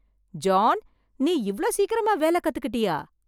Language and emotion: Tamil, surprised